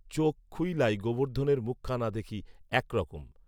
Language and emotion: Bengali, neutral